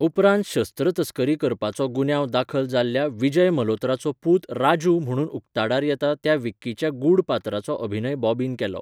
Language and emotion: Goan Konkani, neutral